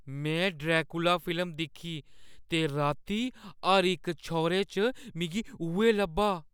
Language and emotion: Dogri, fearful